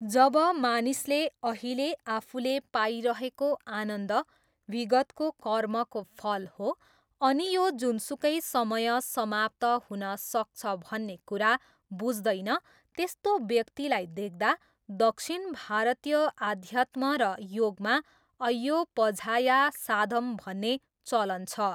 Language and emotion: Nepali, neutral